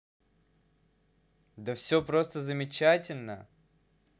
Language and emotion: Russian, positive